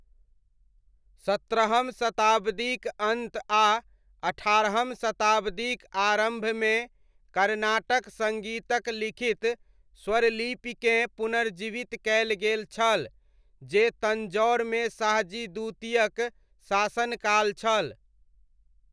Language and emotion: Maithili, neutral